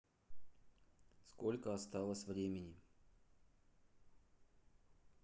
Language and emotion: Russian, neutral